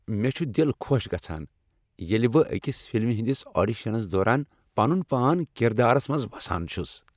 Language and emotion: Kashmiri, happy